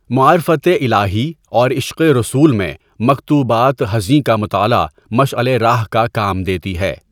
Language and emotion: Urdu, neutral